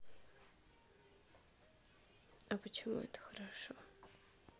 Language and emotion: Russian, sad